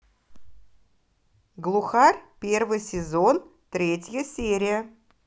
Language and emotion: Russian, positive